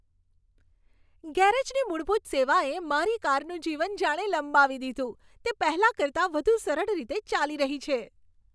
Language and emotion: Gujarati, happy